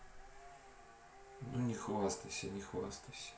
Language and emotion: Russian, neutral